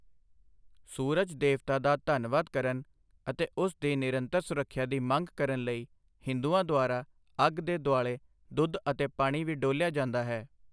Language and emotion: Punjabi, neutral